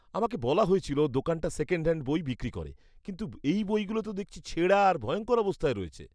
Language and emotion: Bengali, disgusted